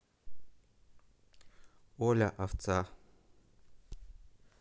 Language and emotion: Russian, neutral